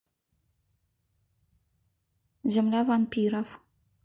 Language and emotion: Russian, neutral